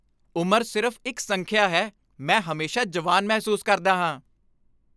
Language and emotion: Punjabi, happy